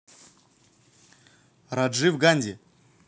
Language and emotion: Russian, neutral